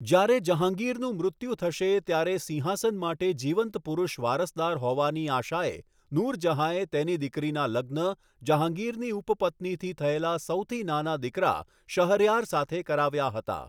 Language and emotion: Gujarati, neutral